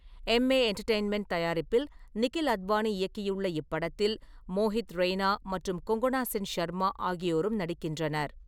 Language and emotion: Tamil, neutral